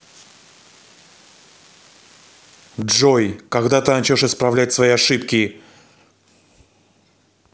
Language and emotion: Russian, angry